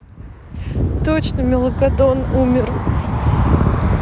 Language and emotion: Russian, sad